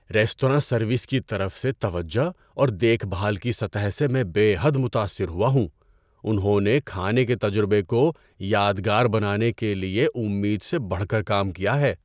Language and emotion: Urdu, surprised